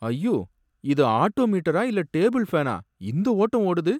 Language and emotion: Tamil, sad